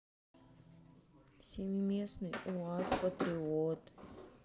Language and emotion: Russian, sad